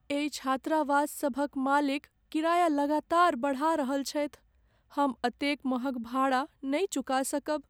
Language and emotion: Maithili, sad